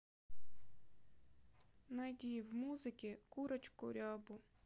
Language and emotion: Russian, sad